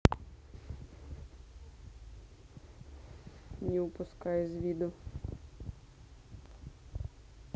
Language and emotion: Russian, neutral